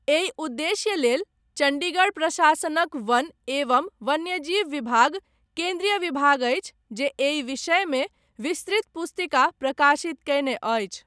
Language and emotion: Maithili, neutral